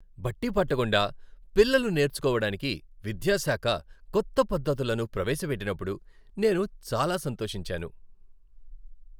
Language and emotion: Telugu, happy